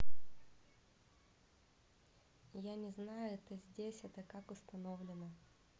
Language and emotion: Russian, neutral